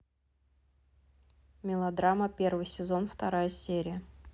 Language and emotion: Russian, neutral